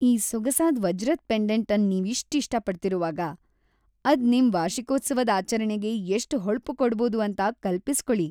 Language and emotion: Kannada, happy